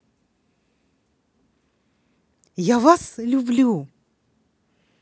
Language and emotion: Russian, positive